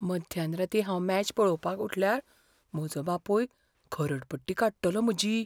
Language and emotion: Goan Konkani, fearful